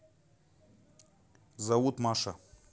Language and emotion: Russian, neutral